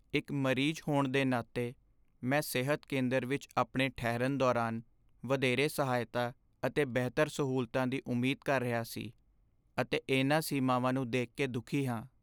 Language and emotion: Punjabi, sad